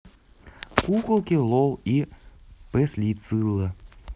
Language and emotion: Russian, neutral